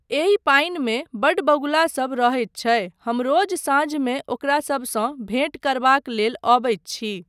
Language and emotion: Maithili, neutral